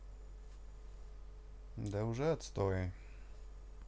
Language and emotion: Russian, neutral